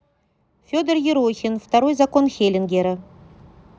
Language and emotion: Russian, neutral